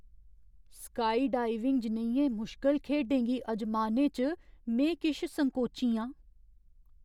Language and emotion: Dogri, fearful